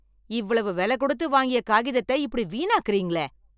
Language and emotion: Tamil, angry